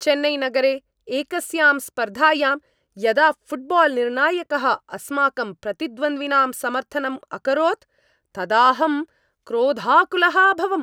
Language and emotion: Sanskrit, angry